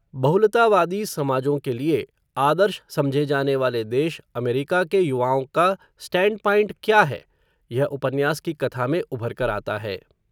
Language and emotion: Hindi, neutral